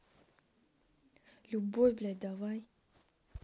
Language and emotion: Russian, angry